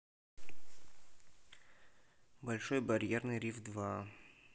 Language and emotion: Russian, neutral